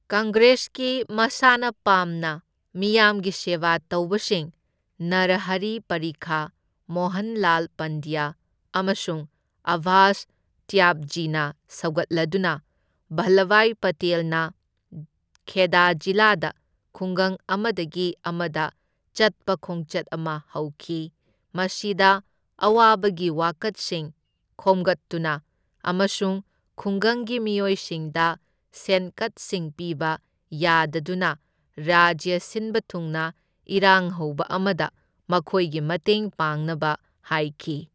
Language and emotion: Manipuri, neutral